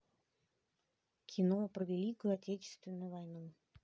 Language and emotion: Russian, neutral